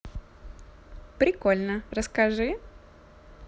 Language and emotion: Russian, positive